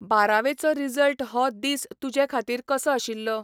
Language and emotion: Goan Konkani, neutral